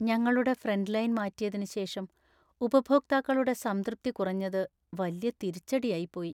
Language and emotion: Malayalam, sad